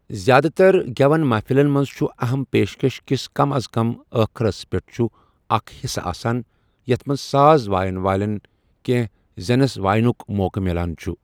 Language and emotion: Kashmiri, neutral